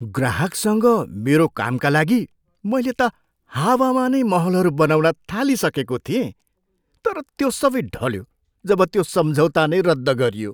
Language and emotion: Nepali, surprised